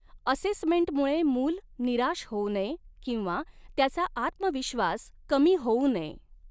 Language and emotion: Marathi, neutral